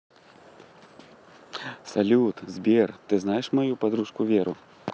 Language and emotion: Russian, positive